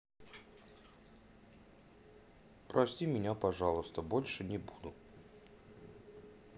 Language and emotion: Russian, sad